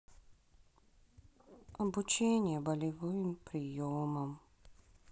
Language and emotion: Russian, sad